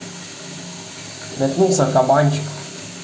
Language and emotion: Russian, neutral